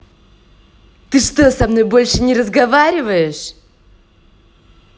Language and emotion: Russian, angry